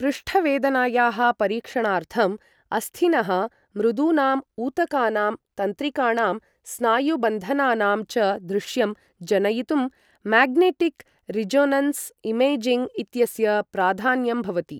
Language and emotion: Sanskrit, neutral